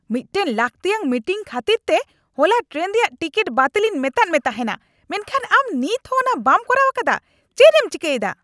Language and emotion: Santali, angry